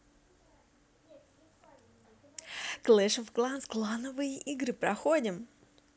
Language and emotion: Russian, positive